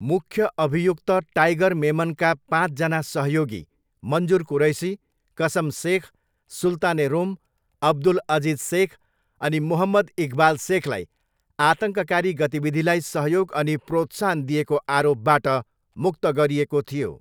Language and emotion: Nepali, neutral